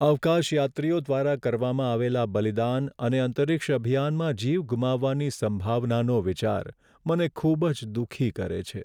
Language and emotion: Gujarati, sad